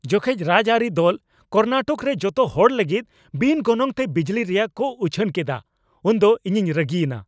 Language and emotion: Santali, angry